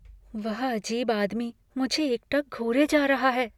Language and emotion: Hindi, fearful